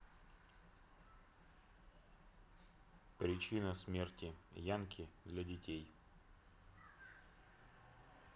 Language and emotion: Russian, neutral